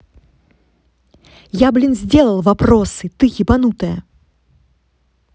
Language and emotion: Russian, angry